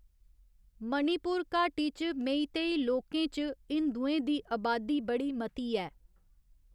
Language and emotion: Dogri, neutral